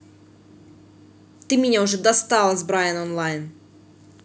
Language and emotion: Russian, angry